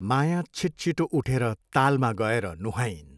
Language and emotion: Nepali, neutral